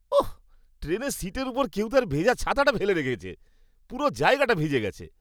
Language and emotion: Bengali, disgusted